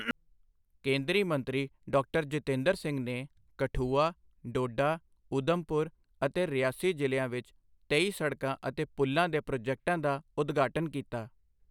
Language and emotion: Punjabi, neutral